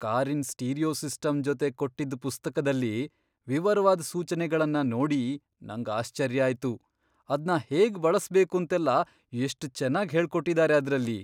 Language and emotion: Kannada, surprised